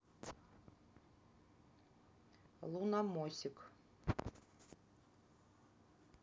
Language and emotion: Russian, neutral